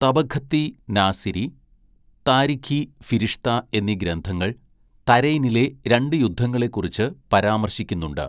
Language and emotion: Malayalam, neutral